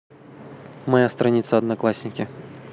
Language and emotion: Russian, neutral